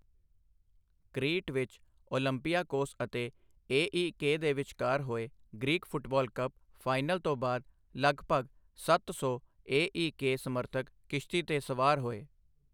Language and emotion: Punjabi, neutral